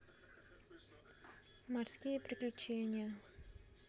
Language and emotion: Russian, neutral